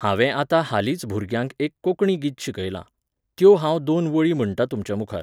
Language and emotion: Goan Konkani, neutral